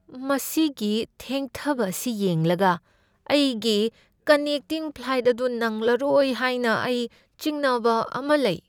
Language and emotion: Manipuri, fearful